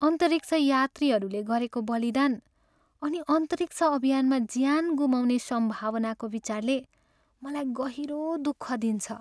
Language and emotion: Nepali, sad